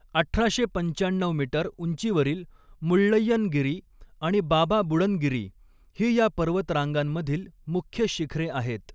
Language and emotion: Marathi, neutral